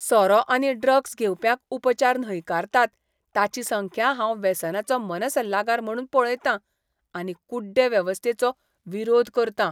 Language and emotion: Goan Konkani, disgusted